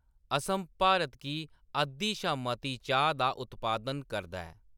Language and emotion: Dogri, neutral